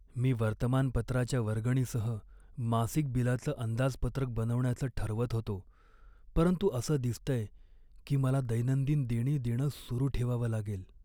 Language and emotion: Marathi, sad